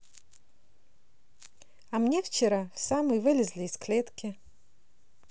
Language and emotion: Russian, positive